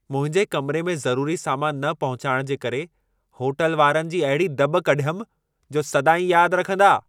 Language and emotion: Sindhi, angry